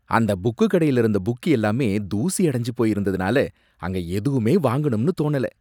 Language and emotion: Tamil, disgusted